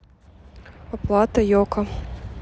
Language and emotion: Russian, neutral